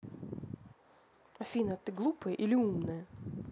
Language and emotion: Russian, angry